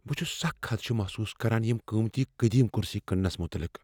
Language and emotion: Kashmiri, fearful